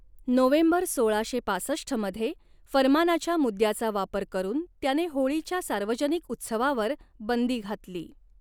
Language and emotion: Marathi, neutral